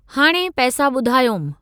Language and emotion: Sindhi, neutral